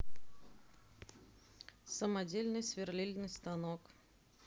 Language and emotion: Russian, neutral